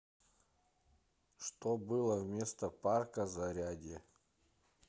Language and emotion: Russian, neutral